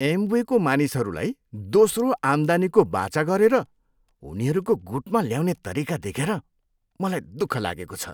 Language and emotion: Nepali, disgusted